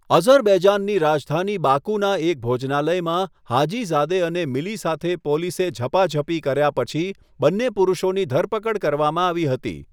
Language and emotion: Gujarati, neutral